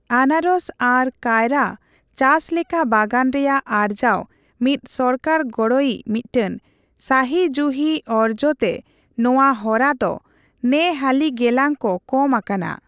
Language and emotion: Santali, neutral